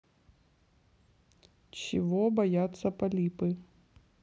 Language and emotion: Russian, neutral